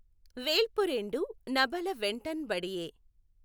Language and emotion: Telugu, neutral